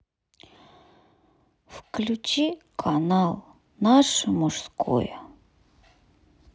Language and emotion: Russian, sad